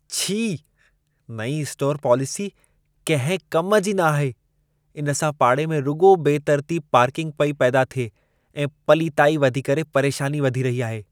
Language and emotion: Sindhi, disgusted